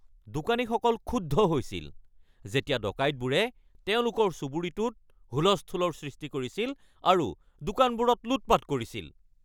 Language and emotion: Assamese, angry